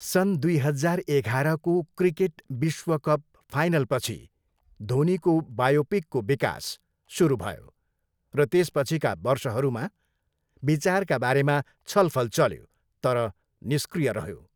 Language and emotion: Nepali, neutral